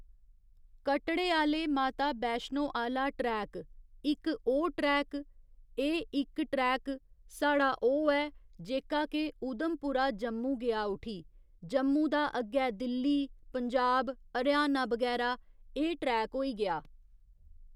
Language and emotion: Dogri, neutral